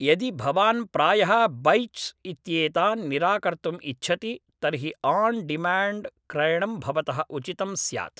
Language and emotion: Sanskrit, neutral